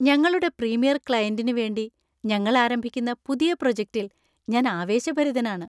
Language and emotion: Malayalam, happy